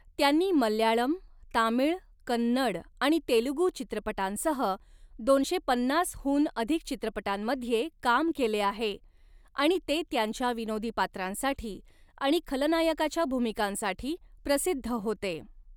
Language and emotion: Marathi, neutral